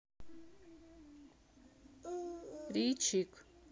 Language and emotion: Russian, neutral